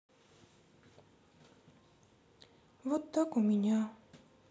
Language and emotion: Russian, sad